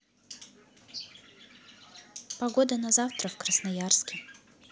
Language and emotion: Russian, neutral